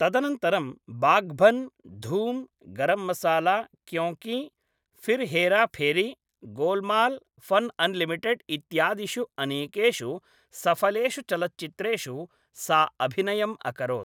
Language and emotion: Sanskrit, neutral